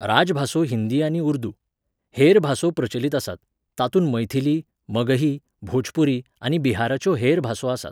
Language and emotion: Goan Konkani, neutral